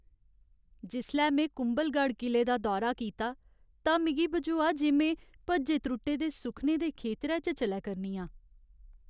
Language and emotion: Dogri, sad